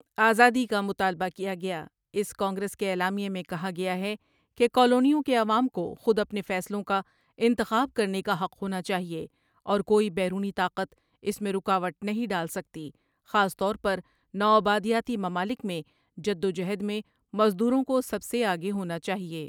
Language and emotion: Urdu, neutral